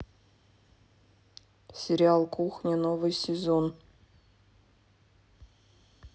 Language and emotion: Russian, neutral